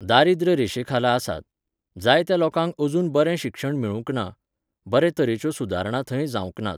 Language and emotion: Goan Konkani, neutral